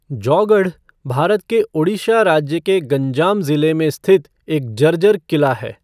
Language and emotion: Hindi, neutral